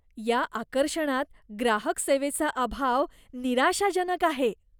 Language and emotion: Marathi, disgusted